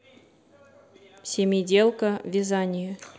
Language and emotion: Russian, neutral